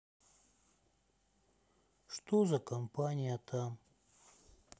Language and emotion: Russian, sad